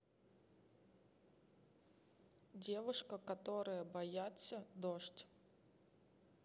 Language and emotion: Russian, neutral